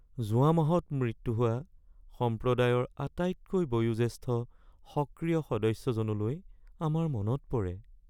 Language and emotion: Assamese, sad